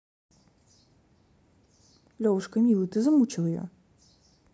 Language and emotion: Russian, neutral